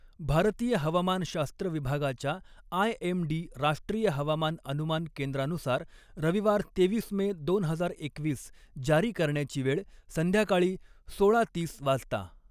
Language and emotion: Marathi, neutral